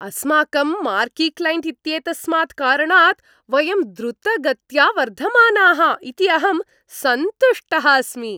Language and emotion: Sanskrit, happy